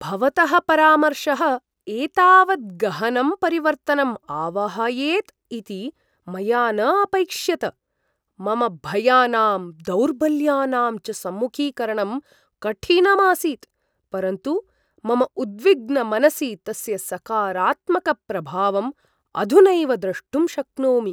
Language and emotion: Sanskrit, surprised